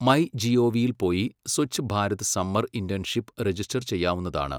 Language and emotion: Malayalam, neutral